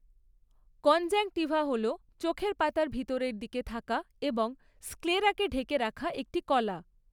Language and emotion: Bengali, neutral